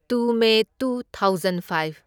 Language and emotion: Manipuri, neutral